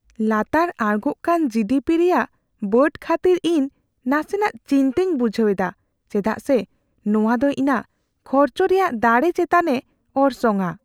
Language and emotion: Santali, fearful